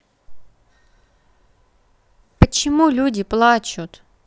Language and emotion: Russian, neutral